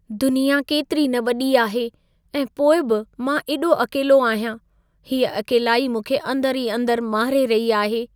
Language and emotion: Sindhi, sad